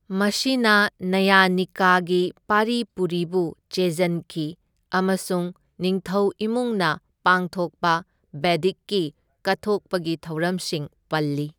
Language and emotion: Manipuri, neutral